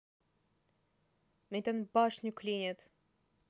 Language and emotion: Russian, neutral